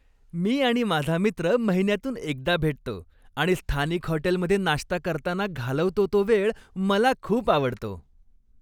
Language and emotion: Marathi, happy